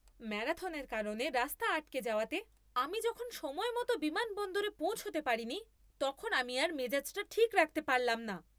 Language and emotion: Bengali, angry